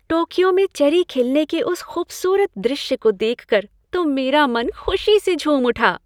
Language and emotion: Hindi, happy